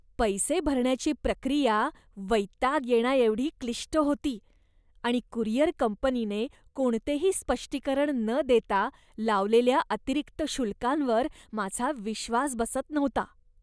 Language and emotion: Marathi, disgusted